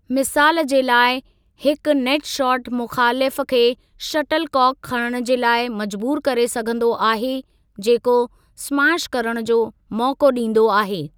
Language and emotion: Sindhi, neutral